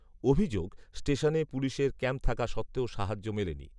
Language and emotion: Bengali, neutral